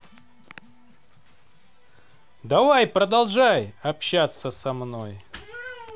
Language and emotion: Russian, positive